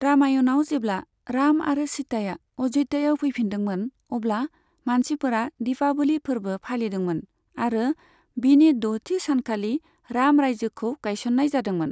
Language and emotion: Bodo, neutral